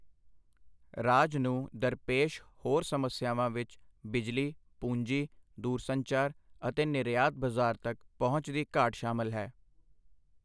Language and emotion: Punjabi, neutral